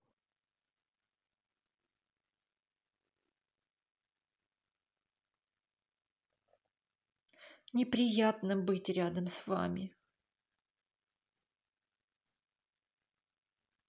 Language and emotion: Russian, sad